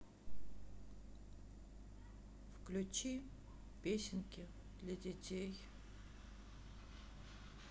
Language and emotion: Russian, sad